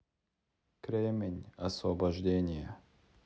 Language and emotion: Russian, neutral